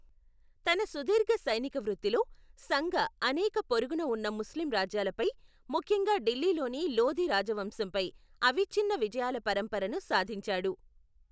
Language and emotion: Telugu, neutral